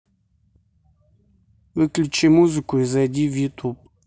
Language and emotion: Russian, neutral